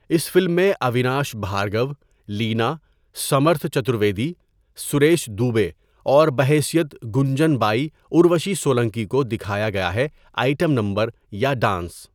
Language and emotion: Urdu, neutral